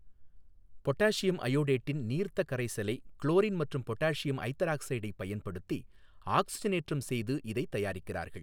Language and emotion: Tamil, neutral